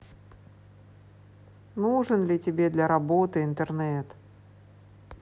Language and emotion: Russian, sad